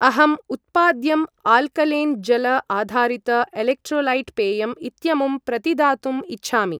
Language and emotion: Sanskrit, neutral